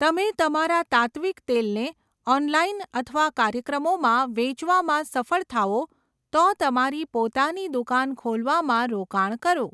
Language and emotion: Gujarati, neutral